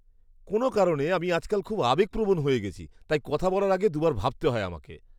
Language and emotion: Bengali, disgusted